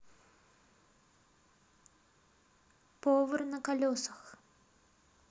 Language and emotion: Russian, neutral